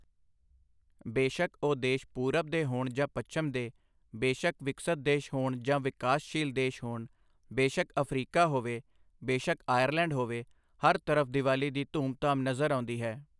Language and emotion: Punjabi, neutral